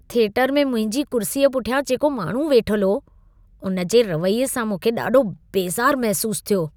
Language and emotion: Sindhi, disgusted